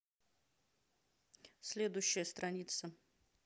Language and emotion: Russian, neutral